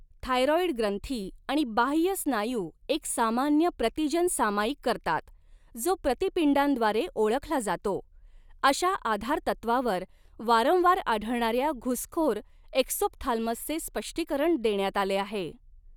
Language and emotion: Marathi, neutral